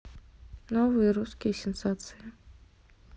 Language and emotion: Russian, neutral